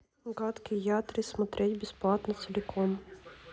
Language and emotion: Russian, neutral